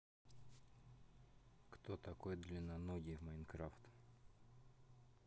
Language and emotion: Russian, neutral